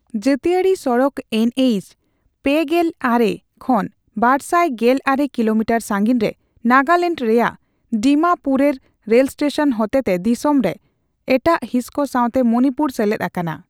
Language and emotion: Santali, neutral